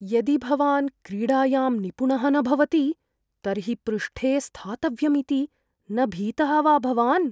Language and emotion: Sanskrit, fearful